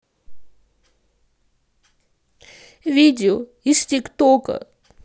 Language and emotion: Russian, sad